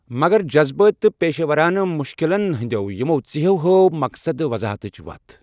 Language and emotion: Kashmiri, neutral